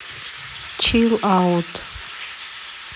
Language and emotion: Russian, neutral